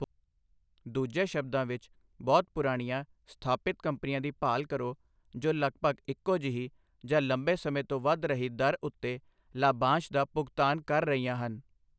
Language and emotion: Punjabi, neutral